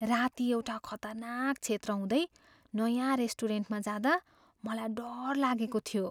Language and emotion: Nepali, fearful